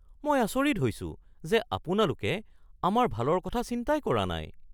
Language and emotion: Assamese, surprised